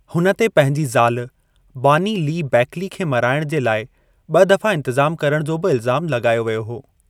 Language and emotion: Sindhi, neutral